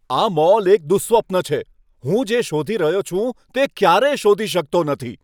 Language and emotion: Gujarati, angry